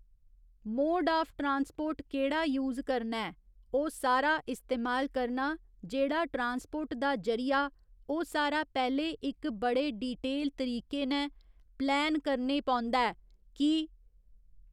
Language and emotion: Dogri, neutral